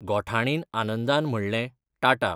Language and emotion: Goan Konkani, neutral